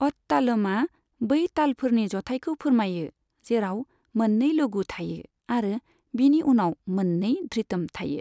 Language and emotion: Bodo, neutral